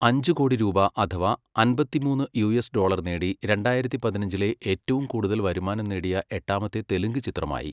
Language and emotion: Malayalam, neutral